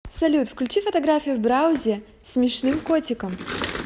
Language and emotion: Russian, positive